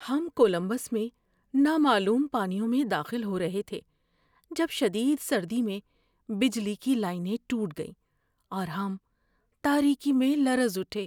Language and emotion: Urdu, fearful